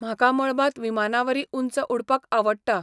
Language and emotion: Goan Konkani, neutral